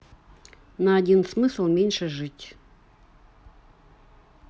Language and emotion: Russian, neutral